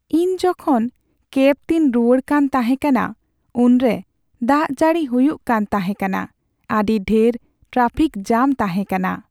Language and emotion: Santali, sad